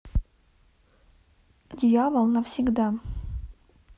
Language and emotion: Russian, neutral